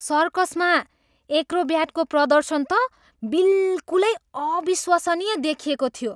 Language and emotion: Nepali, surprised